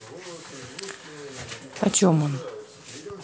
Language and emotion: Russian, neutral